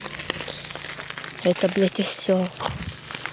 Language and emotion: Russian, angry